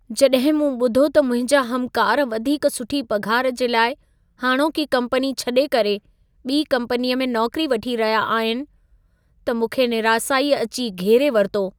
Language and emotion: Sindhi, sad